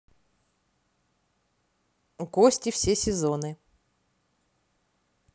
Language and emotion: Russian, neutral